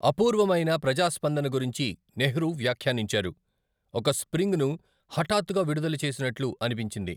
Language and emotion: Telugu, neutral